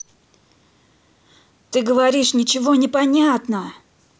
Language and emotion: Russian, angry